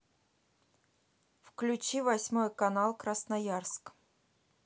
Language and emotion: Russian, neutral